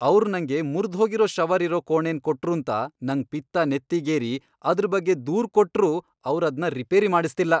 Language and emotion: Kannada, angry